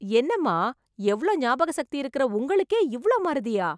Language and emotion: Tamil, surprised